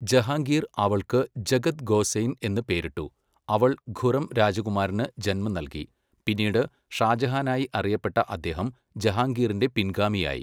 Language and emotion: Malayalam, neutral